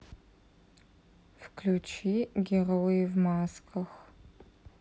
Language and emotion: Russian, sad